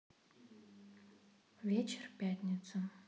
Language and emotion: Russian, neutral